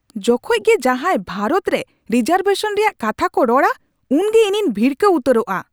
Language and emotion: Santali, angry